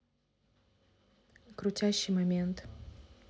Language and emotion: Russian, neutral